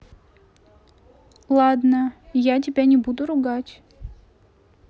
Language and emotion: Russian, neutral